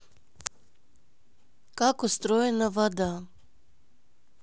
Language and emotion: Russian, neutral